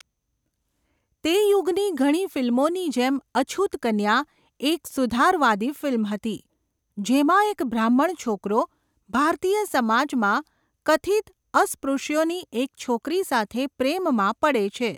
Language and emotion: Gujarati, neutral